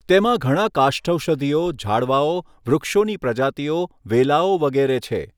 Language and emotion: Gujarati, neutral